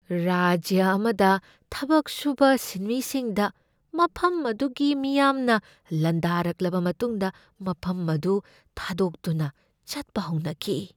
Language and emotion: Manipuri, fearful